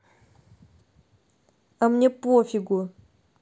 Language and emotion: Russian, angry